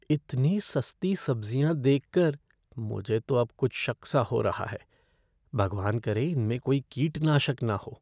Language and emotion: Hindi, fearful